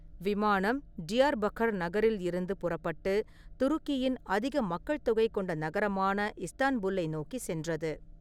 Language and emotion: Tamil, neutral